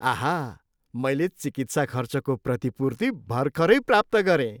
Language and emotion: Nepali, happy